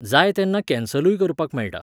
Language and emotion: Goan Konkani, neutral